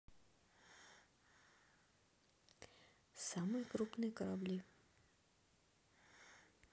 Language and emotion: Russian, neutral